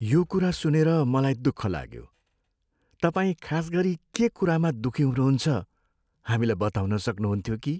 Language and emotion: Nepali, sad